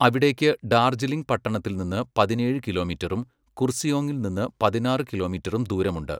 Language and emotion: Malayalam, neutral